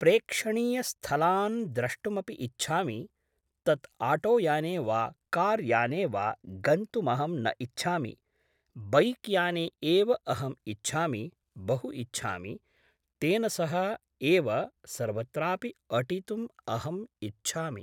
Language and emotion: Sanskrit, neutral